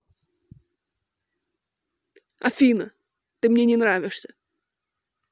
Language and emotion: Russian, angry